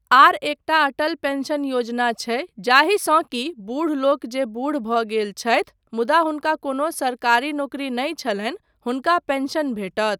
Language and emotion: Maithili, neutral